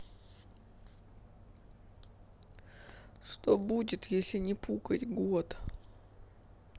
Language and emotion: Russian, sad